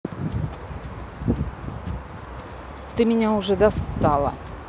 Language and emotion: Russian, angry